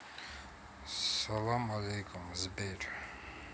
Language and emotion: Russian, sad